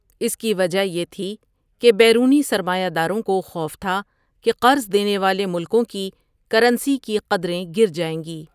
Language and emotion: Urdu, neutral